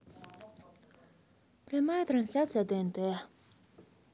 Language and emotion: Russian, sad